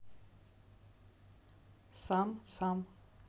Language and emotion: Russian, neutral